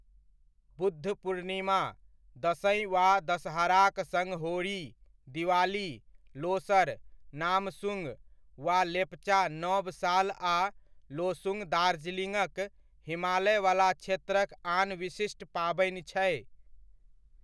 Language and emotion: Maithili, neutral